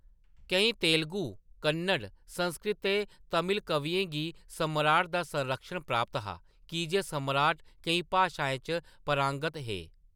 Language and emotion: Dogri, neutral